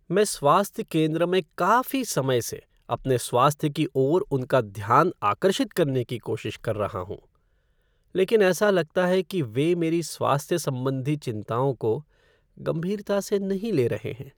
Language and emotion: Hindi, sad